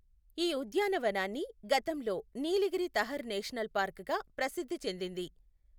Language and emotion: Telugu, neutral